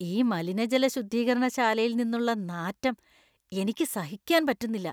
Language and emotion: Malayalam, disgusted